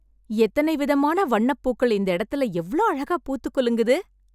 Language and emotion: Tamil, happy